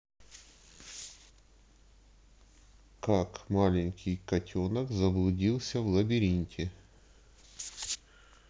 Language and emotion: Russian, neutral